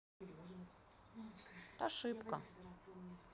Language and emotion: Russian, neutral